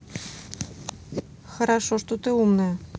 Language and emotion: Russian, neutral